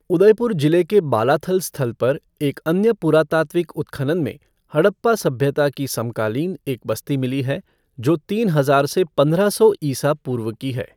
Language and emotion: Hindi, neutral